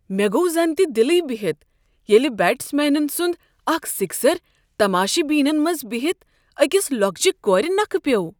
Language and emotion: Kashmiri, surprised